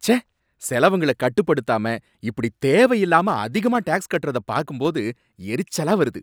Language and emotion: Tamil, angry